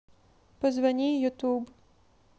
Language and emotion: Russian, neutral